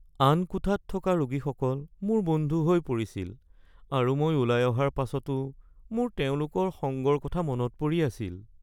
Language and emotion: Assamese, sad